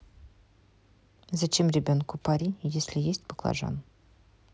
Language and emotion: Russian, neutral